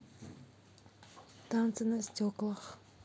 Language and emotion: Russian, neutral